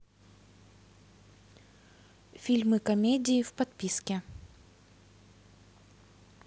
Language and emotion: Russian, neutral